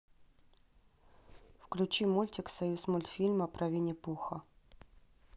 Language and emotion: Russian, neutral